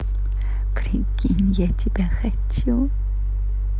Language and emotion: Russian, positive